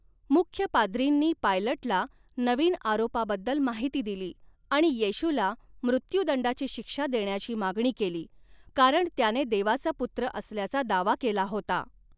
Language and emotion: Marathi, neutral